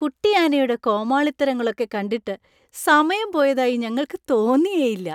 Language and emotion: Malayalam, happy